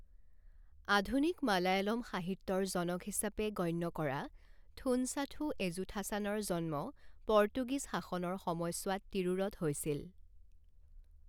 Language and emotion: Assamese, neutral